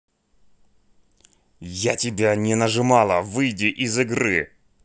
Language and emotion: Russian, angry